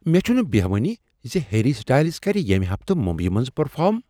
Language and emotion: Kashmiri, surprised